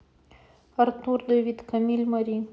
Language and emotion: Russian, neutral